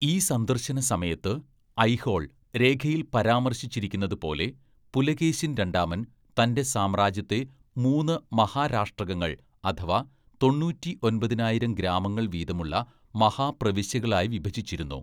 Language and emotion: Malayalam, neutral